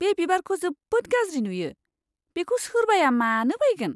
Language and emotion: Bodo, disgusted